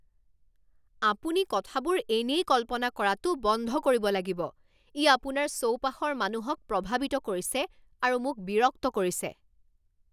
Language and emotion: Assamese, angry